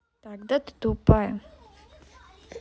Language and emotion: Russian, neutral